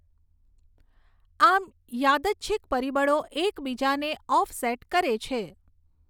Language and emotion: Gujarati, neutral